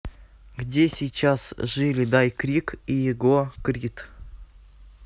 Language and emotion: Russian, neutral